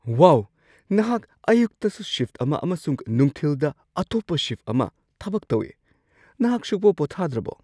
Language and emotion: Manipuri, surprised